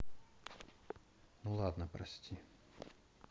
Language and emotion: Russian, sad